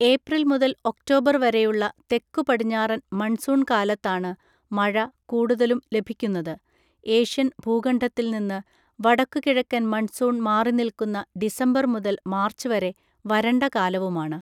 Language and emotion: Malayalam, neutral